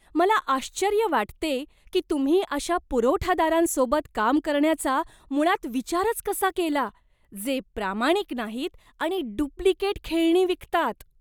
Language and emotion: Marathi, disgusted